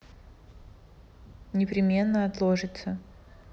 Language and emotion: Russian, neutral